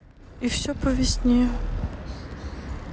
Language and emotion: Russian, sad